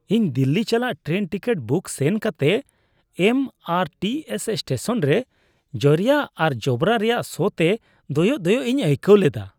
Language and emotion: Santali, disgusted